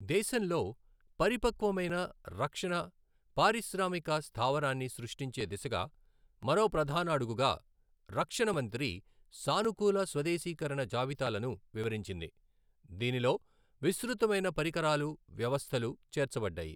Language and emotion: Telugu, neutral